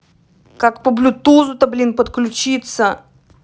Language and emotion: Russian, angry